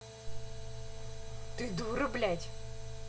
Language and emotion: Russian, angry